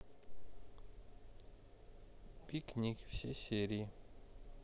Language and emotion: Russian, neutral